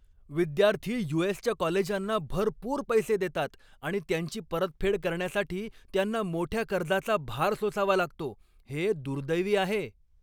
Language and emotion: Marathi, angry